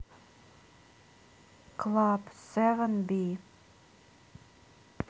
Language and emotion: Russian, neutral